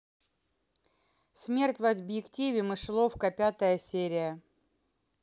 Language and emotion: Russian, neutral